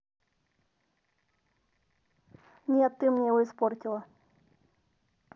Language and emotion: Russian, neutral